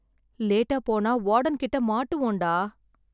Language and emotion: Tamil, sad